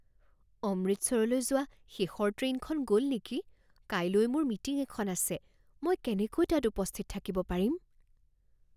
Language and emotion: Assamese, fearful